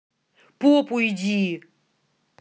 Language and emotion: Russian, angry